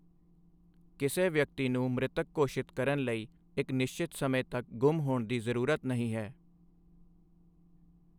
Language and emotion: Punjabi, neutral